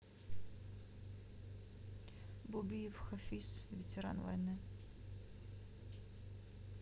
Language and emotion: Russian, neutral